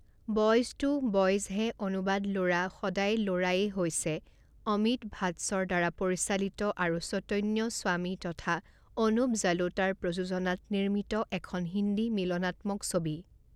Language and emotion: Assamese, neutral